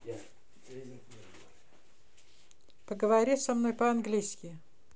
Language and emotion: Russian, neutral